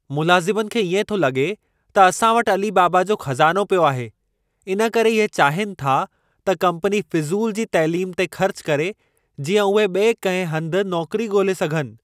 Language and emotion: Sindhi, angry